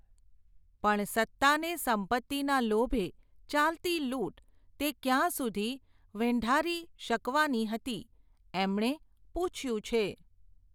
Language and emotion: Gujarati, neutral